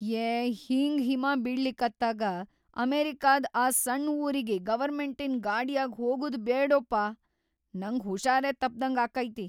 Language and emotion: Kannada, fearful